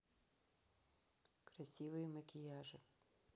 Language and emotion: Russian, neutral